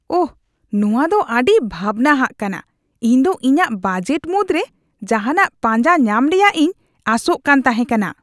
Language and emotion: Santali, disgusted